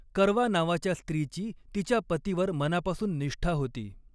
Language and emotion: Marathi, neutral